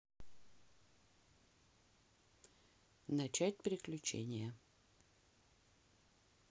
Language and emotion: Russian, neutral